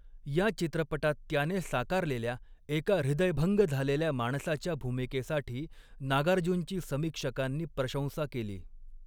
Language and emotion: Marathi, neutral